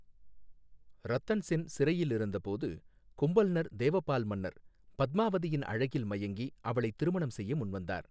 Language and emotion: Tamil, neutral